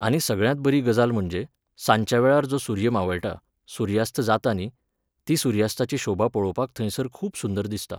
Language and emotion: Goan Konkani, neutral